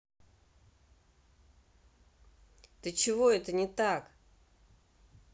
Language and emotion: Russian, angry